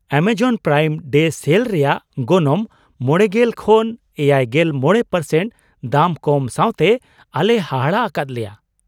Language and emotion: Santali, surprised